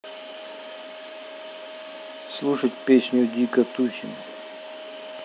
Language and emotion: Russian, neutral